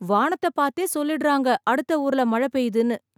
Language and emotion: Tamil, surprised